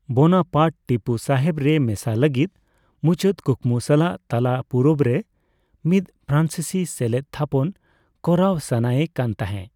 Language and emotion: Santali, neutral